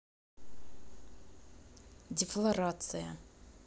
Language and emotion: Russian, neutral